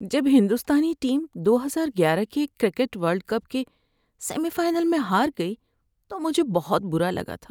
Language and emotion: Urdu, sad